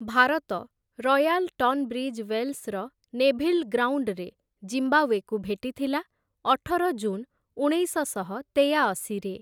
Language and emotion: Odia, neutral